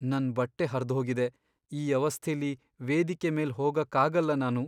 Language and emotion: Kannada, sad